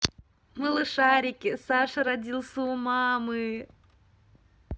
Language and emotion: Russian, positive